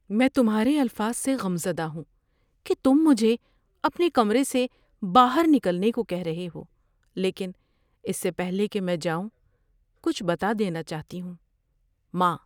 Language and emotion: Urdu, sad